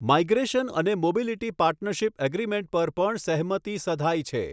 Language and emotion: Gujarati, neutral